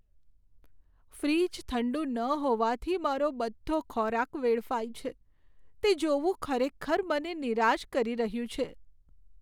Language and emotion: Gujarati, sad